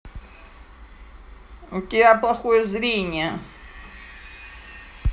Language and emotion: Russian, angry